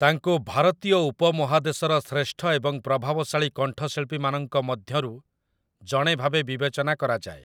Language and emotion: Odia, neutral